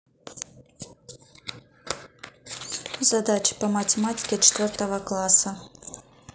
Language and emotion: Russian, neutral